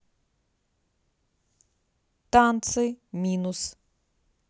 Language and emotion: Russian, neutral